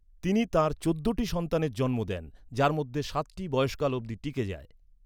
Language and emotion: Bengali, neutral